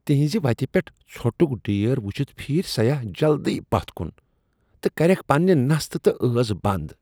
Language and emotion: Kashmiri, disgusted